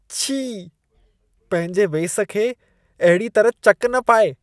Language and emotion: Sindhi, disgusted